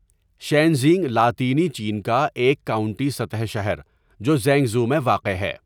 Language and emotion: Urdu, neutral